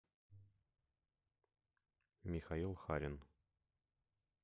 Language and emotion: Russian, neutral